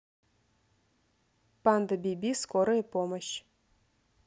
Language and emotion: Russian, neutral